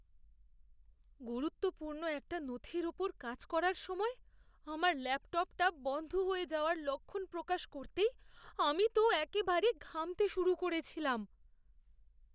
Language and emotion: Bengali, fearful